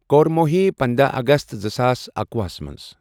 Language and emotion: Kashmiri, neutral